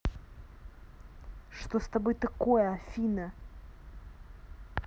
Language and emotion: Russian, angry